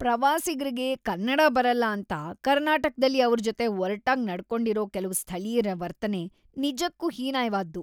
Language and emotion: Kannada, disgusted